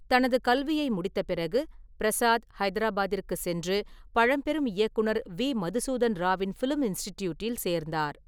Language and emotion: Tamil, neutral